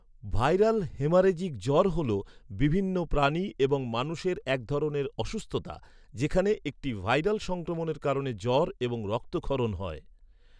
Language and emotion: Bengali, neutral